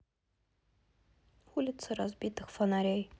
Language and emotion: Russian, neutral